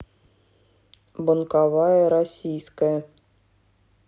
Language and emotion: Russian, neutral